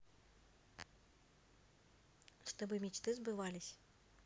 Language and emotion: Russian, neutral